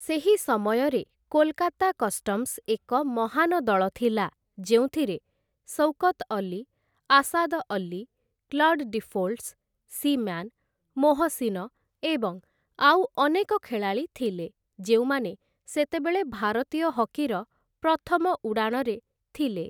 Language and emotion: Odia, neutral